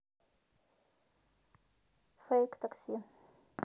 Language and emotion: Russian, neutral